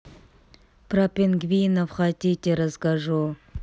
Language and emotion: Russian, neutral